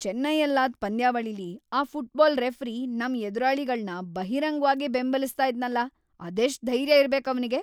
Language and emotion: Kannada, angry